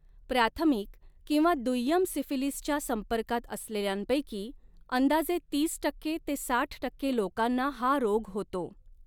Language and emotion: Marathi, neutral